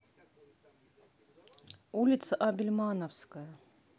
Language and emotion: Russian, neutral